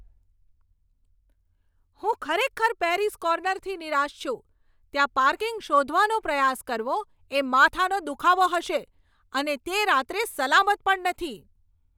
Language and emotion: Gujarati, angry